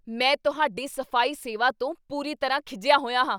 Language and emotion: Punjabi, angry